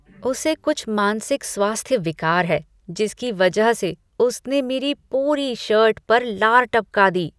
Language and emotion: Hindi, disgusted